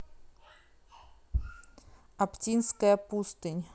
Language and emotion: Russian, neutral